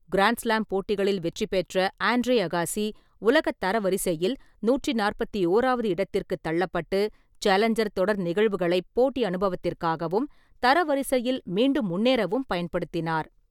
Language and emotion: Tamil, neutral